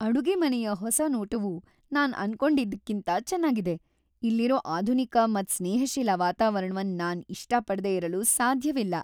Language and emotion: Kannada, happy